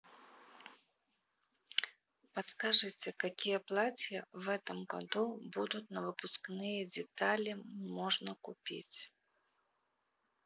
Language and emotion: Russian, neutral